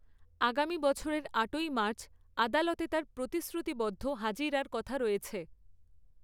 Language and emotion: Bengali, neutral